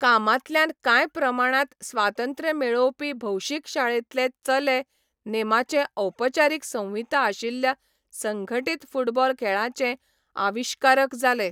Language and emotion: Goan Konkani, neutral